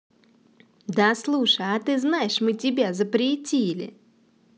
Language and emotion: Russian, positive